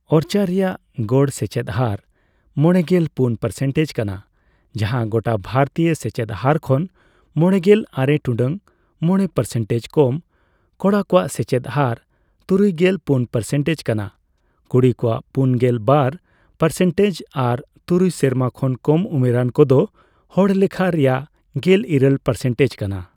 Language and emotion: Santali, neutral